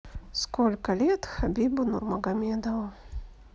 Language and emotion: Russian, neutral